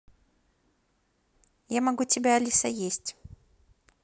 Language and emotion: Russian, neutral